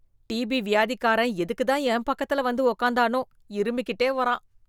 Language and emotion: Tamil, disgusted